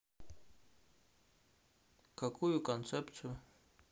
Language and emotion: Russian, neutral